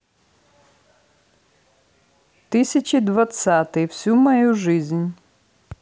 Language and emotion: Russian, neutral